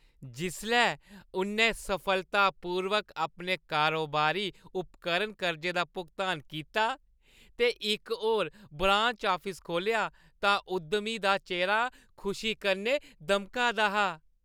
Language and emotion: Dogri, happy